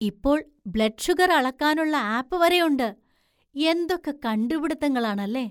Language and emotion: Malayalam, surprised